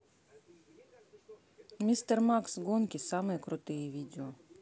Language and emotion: Russian, neutral